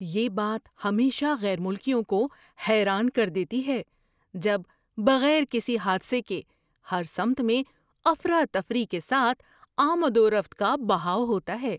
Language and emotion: Urdu, surprised